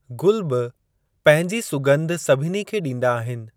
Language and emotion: Sindhi, neutral